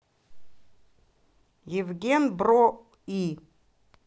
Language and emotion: Russian, neutral